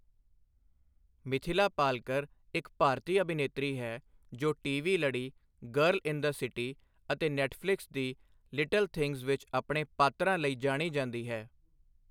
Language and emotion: Punjabi, neutral